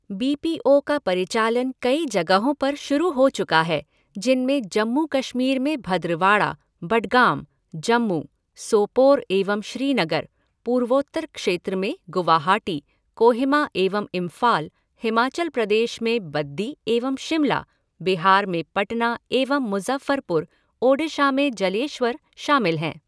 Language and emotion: Hindi, neutral